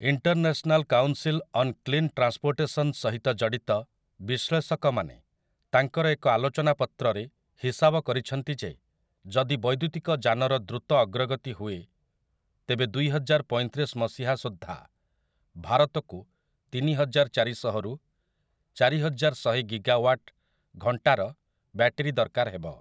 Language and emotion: Odia, neutral